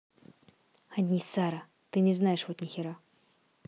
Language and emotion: Russian, angry